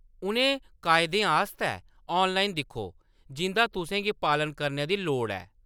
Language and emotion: Dogri, neutral